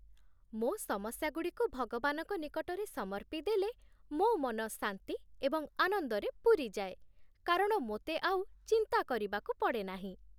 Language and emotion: Odia, happy